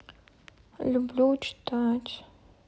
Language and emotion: Russian, sad